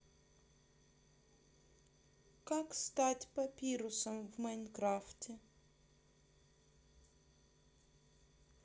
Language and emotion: Russian, neutral